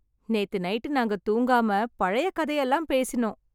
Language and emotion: Tamil, happy